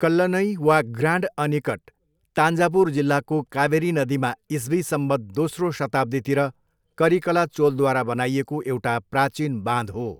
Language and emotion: Nepali, neutral